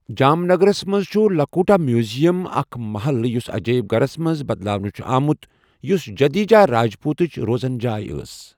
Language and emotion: Kashmiri, neutral